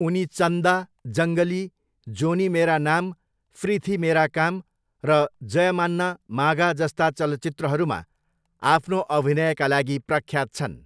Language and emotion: Nepali, neutral